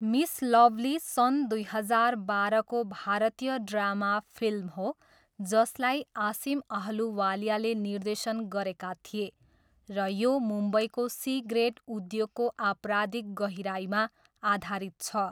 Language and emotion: Nepali, neutral